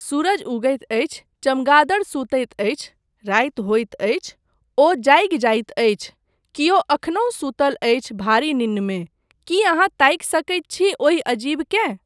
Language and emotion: Maithili, neutral